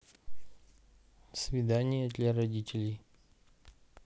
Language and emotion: Russian, neutral